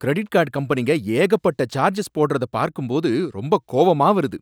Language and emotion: Tamil, angry